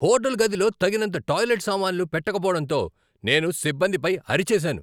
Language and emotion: Telugu, angry